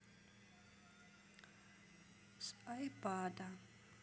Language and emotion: Russian, neutral